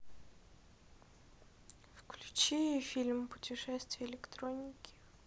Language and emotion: Russian, sad